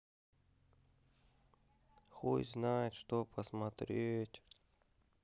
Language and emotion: Russian, sad